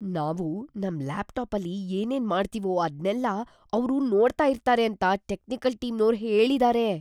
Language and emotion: Kannada, fearful